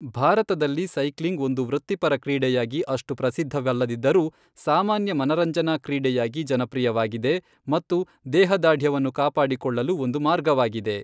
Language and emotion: Kannada, neutral